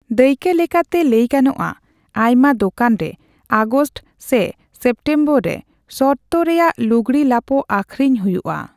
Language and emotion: Santali, neutral